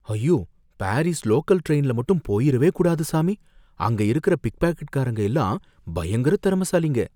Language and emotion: Tamil, fearful